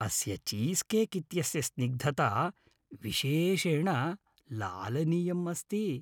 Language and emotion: Sanskrit, happy